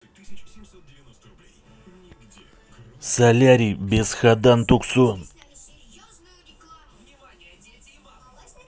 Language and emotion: Russian, angry